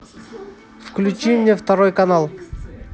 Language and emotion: Russian, neutral